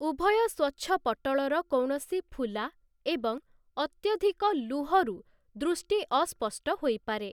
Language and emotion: Odia, neutral